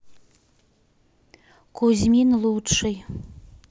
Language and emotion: Russian, neutral